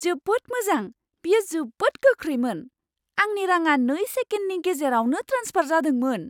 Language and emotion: Bodo, surprised